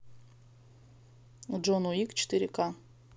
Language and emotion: Russian, neutral